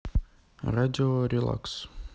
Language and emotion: Russian, neutral